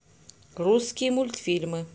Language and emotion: Russian, neutral